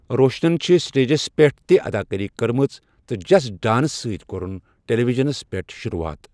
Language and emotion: Kashmiri, neutral